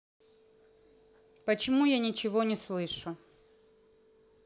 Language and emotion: Russian, neutral